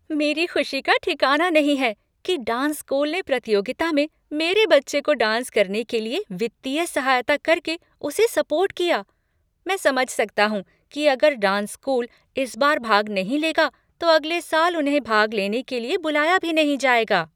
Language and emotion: Hindi, happy